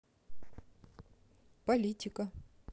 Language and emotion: Russian, neutral